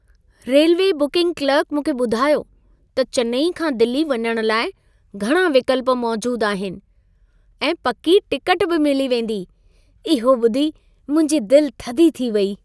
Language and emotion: Sindhi, happy